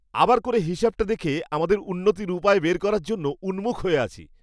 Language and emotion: Bengali, happy